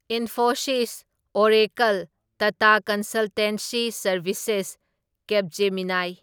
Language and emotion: Manipuri, neutral